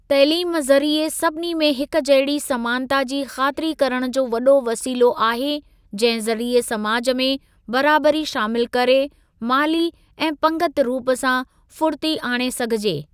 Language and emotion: Sindhi, neutral